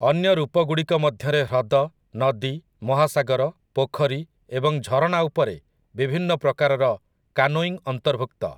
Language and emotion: Odia, neutral